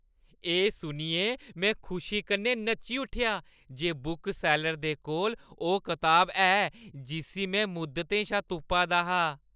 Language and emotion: Dogri, happy